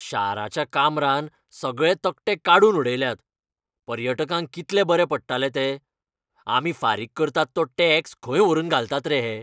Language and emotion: Goan Konkani, angry